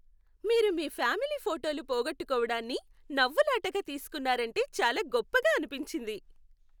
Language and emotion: Telugu, happy